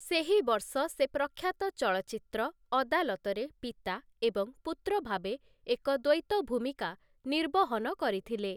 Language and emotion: Odia, neutral